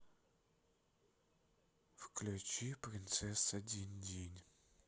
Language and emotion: Russian, sad